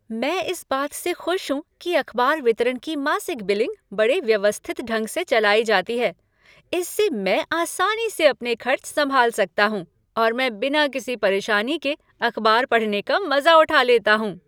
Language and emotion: Hindi, happy